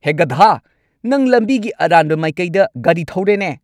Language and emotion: Manipuri, angry